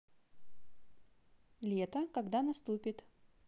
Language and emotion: Russian, neutral